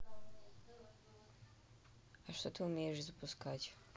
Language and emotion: Russian, neutral